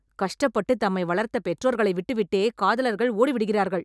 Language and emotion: Tamil, angry